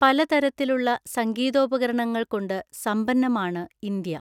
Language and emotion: Malayalam, neutral